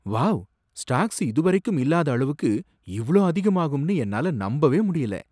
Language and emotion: Tamil, surprised